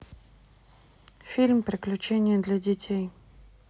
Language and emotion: Russian, neutral